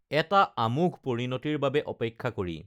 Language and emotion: Assamese, neutral